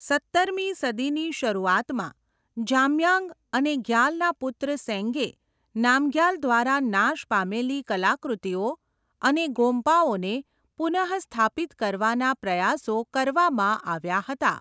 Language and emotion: Gujarati, neutral